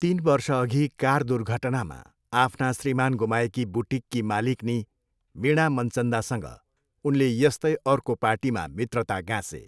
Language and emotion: Nepali, neutral